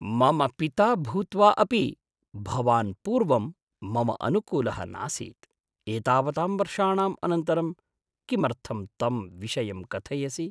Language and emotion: Sanskrit, surprised